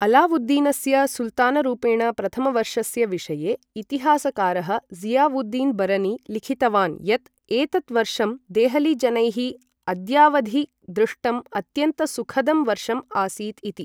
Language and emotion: Sanskrit, neutral